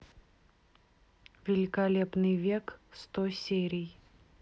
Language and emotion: Russian, neutral